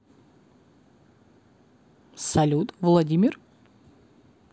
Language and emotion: Russian, positive